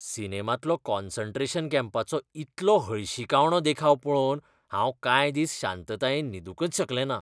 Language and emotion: Goan Konkani, disgusted